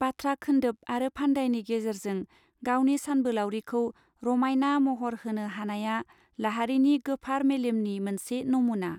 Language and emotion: Bodo, neutral